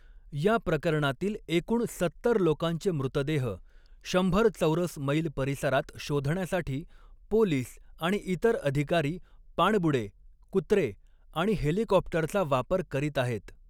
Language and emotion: Marathi, neutral